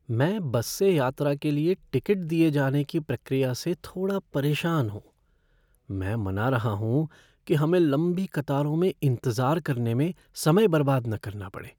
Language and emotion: Hindi, fearful